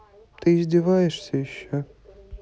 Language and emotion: Russian, neutral